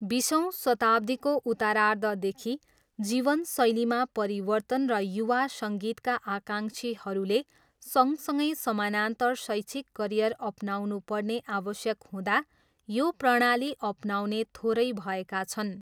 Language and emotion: Nepali, neutral